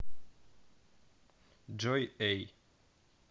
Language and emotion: Russian, neutral